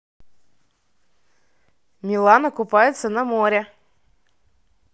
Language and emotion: Russian, positive